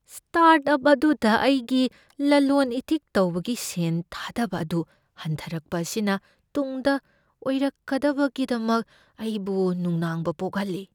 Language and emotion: Manipuri, fearful